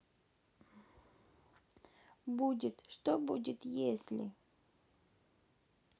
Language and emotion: Russian, sad